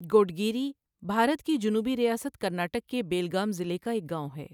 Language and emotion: Urdu, neutral